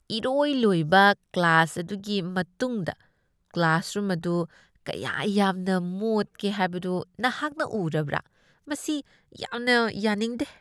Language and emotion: Manipuri, disgusted